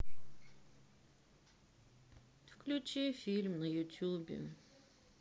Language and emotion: Russian, sad